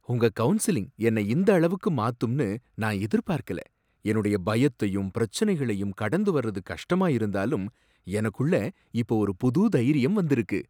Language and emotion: Tamil, surprised